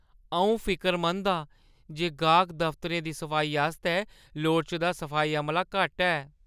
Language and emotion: Dogri, fearful